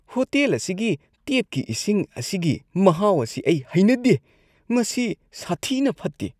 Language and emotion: Manipuri, disgusted